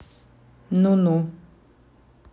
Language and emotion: Russian, angry